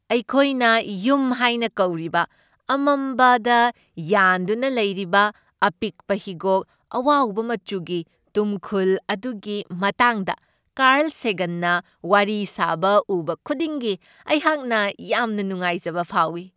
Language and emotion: Manipuri, happy